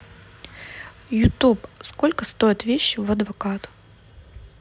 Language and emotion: Russian, neutral